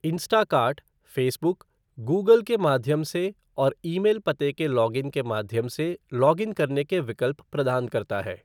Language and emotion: Hindi, neutral